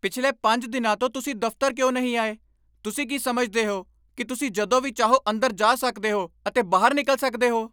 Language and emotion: Punjabi, angry